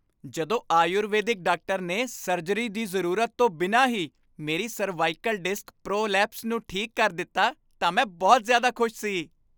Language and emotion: Punjabi, happy